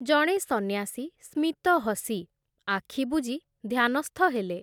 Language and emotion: Odia, neutral